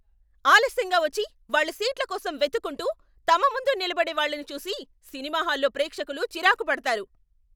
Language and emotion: Telugu, angry